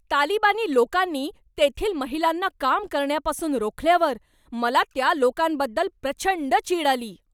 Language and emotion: Marathi, angry